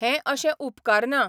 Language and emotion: Goan Konkani, neutral